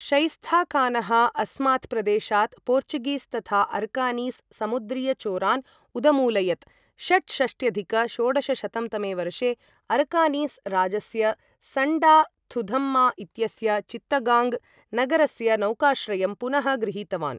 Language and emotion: Sanskrit, neutral